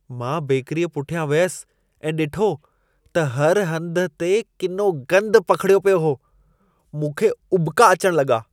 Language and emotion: Sindhi, disgusted